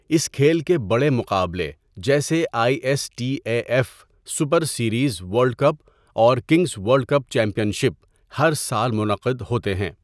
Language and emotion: Urdu, neutral